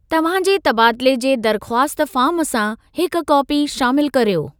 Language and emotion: Sindhi, neutral